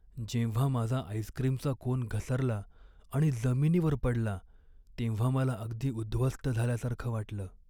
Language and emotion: Marathi, sad